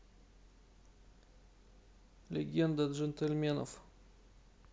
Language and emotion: Russian, neutral